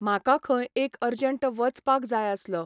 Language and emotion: Goan Konkani, neutral